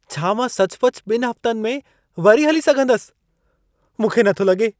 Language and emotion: Sindhi, surprised